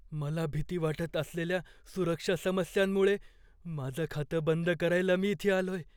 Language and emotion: Marathi, fearful